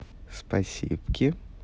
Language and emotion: Russian, positive